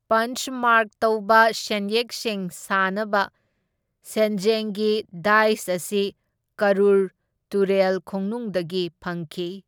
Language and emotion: Manipuri, neutral